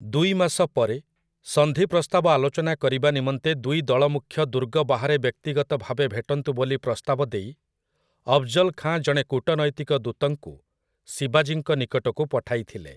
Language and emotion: Odia, neutral